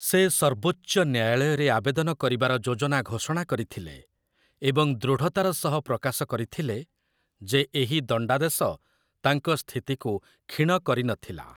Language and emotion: Odia, neutral